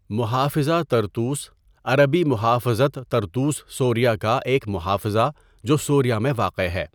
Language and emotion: Urdu, neutral